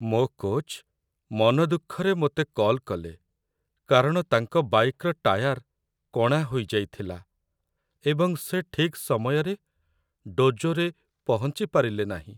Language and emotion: Odia, sad